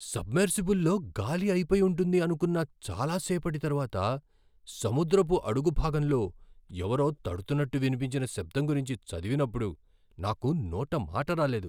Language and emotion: Telugu, surprised